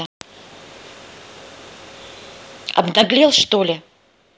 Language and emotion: Russian, angry